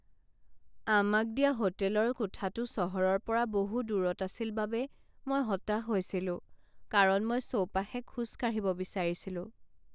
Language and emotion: Assamese, sad